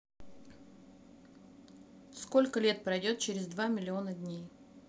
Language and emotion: Russian, neutral